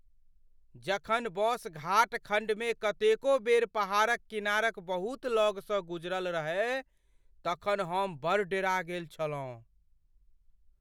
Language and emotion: Maithili, fearful